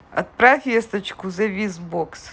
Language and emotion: Russian, positive